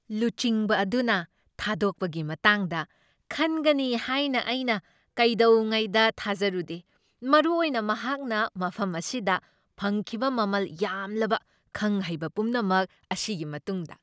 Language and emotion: Manipuri, surprised